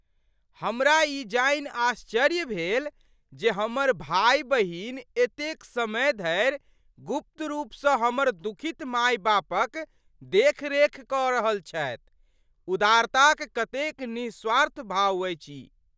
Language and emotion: Maithili, surprised